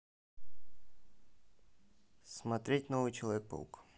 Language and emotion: Russian, neutral